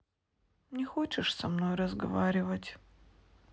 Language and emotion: Russian, sad